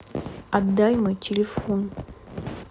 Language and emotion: Russian, neutral